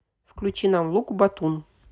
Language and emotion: Russian, neutral